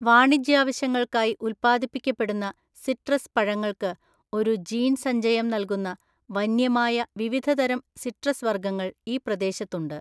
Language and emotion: Malayalam, neutral